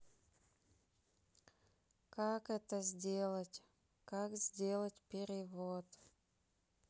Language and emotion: Russian, sad